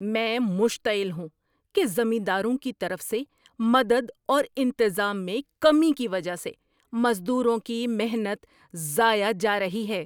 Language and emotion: Urdu, angry